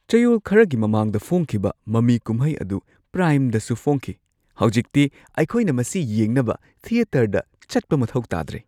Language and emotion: Manipuri, surprised